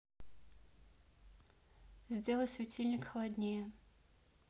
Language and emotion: Russian, neutral